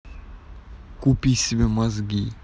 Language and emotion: Russian, angry